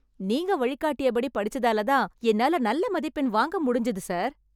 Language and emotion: Tamil, happy